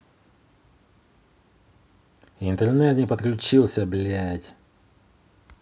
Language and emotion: Russian, angry